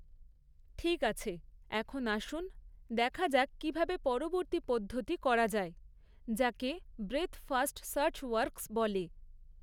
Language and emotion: Bengali, neutral